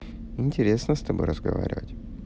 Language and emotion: Russian, neutral